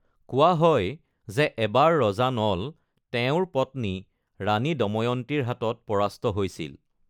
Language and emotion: Assamese, neutral